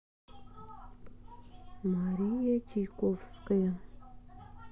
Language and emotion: Russian, neutral